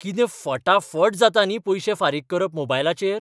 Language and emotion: Goan Konkani, surprised